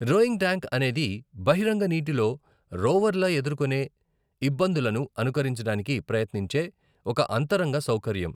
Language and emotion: Telugu, neutral